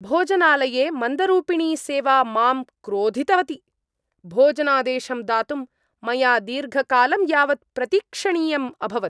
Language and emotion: Sanskrit, angry